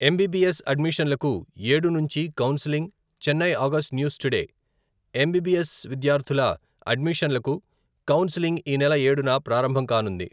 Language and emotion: Telugu, neutral